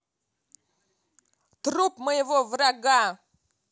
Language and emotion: Russian, angry